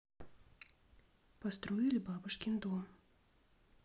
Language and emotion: Russian, neutral